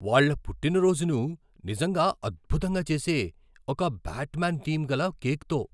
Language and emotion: Telugu, surprised